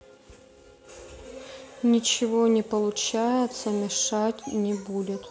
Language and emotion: Russian, sad